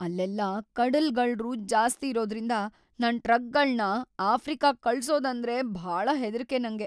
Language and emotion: Kannada, fearful